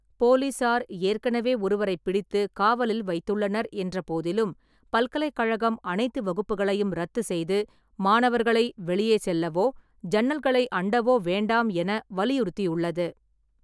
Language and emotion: Tamil, neutral